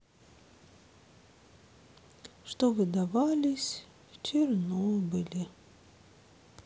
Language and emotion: Russian, sad